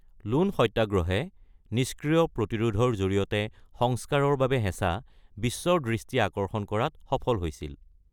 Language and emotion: Assamese, neutral